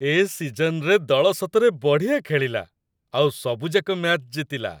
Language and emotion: Odia, happy